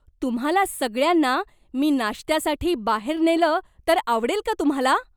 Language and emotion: Marathi, surprised